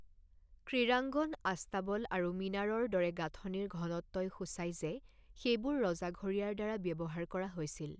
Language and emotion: Assamese, neutral